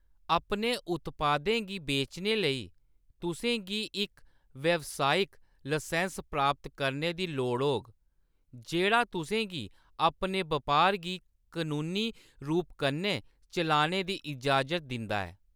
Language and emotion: Dogri, neutral